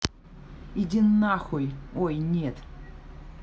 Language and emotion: Russian, angry